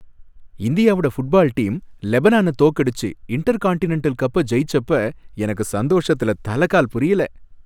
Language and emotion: Tamil, happy